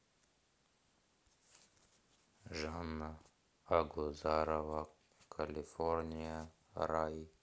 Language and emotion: Russian, sad